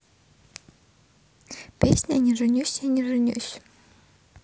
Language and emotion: Russian, neutral